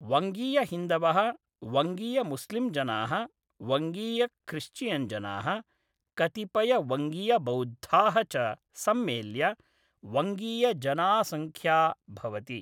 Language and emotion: Sanskrit, neutral